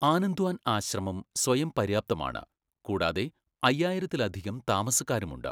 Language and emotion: Malayalam, neutral